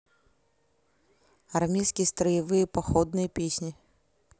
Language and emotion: Russian, neutral